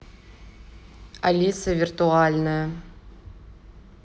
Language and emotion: Russian, neutral